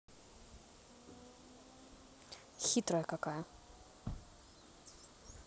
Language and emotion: Russian, angry